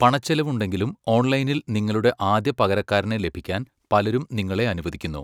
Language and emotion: Malayalam, neutral